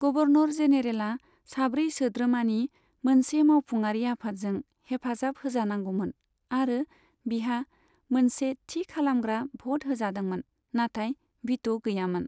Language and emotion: Bodo, neutral